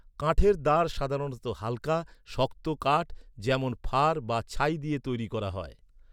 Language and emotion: Bengali, neutral